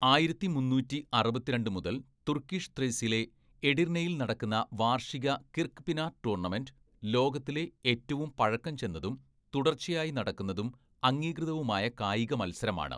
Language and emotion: Malayalam, neutral